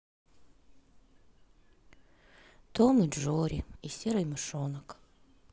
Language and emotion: Russian, sad